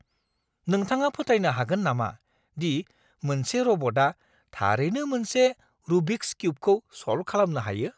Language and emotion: Bodo, surprised